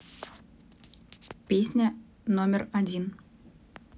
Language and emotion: Russian, neutral